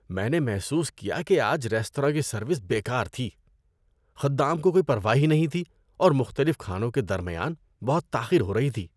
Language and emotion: Urdu, disgusted